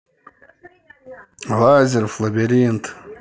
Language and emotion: Russian, neutral